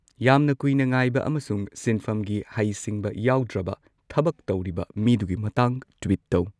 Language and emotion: Manipuri, neutral